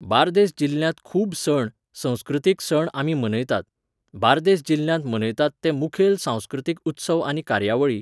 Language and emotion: Goan Konkani, neutral